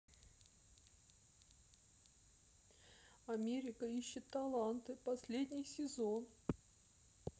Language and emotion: Russian, sad